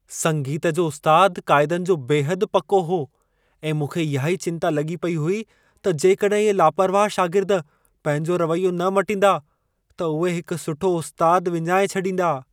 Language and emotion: Sindhi, fearful